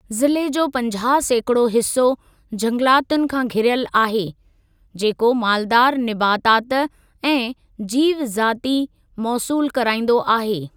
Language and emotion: Sindhi, neutral